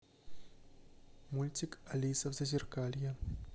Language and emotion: Russian, neutral